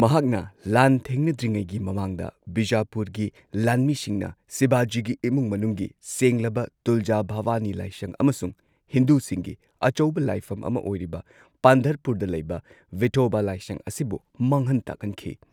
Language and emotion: Manipuri, neutral